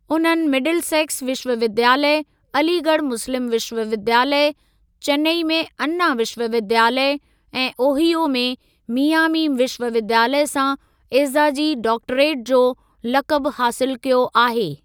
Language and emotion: Sindhi, neutral